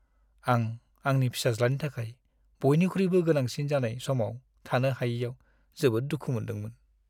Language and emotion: Bodo, sad